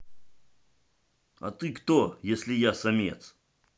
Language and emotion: Russian, angry